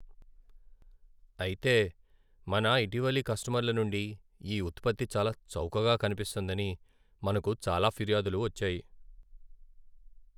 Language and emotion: Telugu, sad